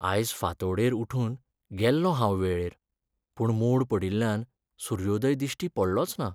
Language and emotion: Goan Konkani, sad